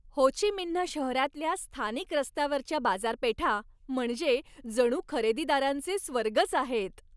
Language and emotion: Marathi, happy